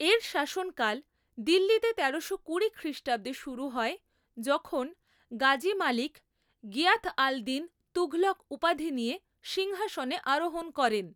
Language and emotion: Bengali, neutral